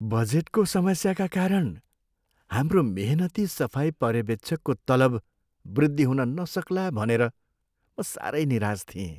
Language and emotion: Nepali, sad